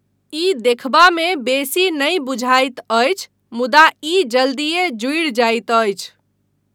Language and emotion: Maithili, neutral